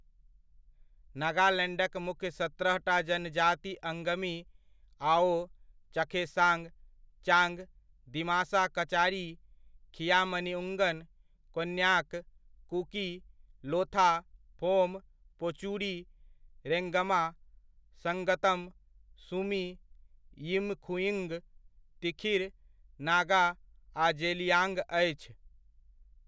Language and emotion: Maithili, neutral